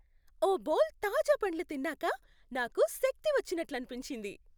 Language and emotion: Telugu, happy